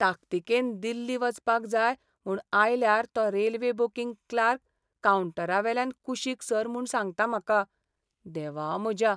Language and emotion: Goan Konkani, sad